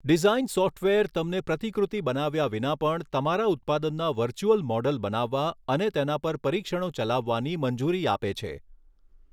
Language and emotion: Gujarati, neutral